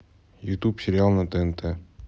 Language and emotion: Russian, neutral